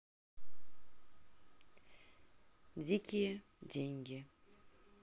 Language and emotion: Russian, neutral